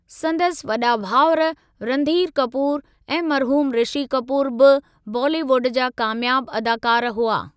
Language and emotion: Sindhi, neutral